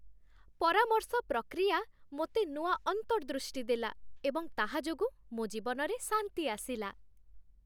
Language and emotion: Odia, happy